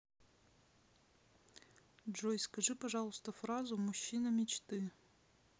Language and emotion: Russian, neutral